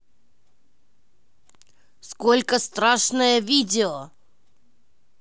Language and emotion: Russian, angry